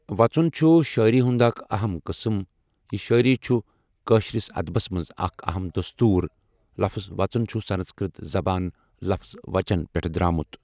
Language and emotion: Kashmiri, neutral